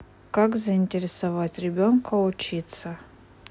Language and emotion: Russian, neutral